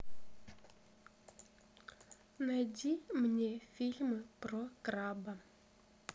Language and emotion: Russian, neutral